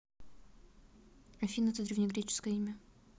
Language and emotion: Russian, neutral